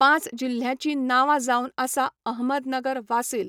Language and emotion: Goan Konkani, neutral